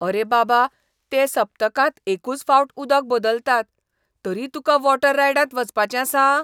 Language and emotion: Goan Konkani, disgusted